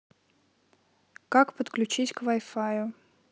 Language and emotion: Russian, neutral